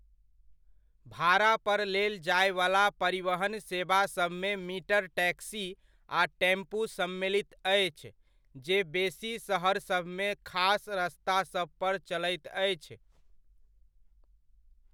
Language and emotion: Maithili, neutral